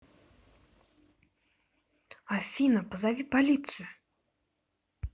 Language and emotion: Russian, angry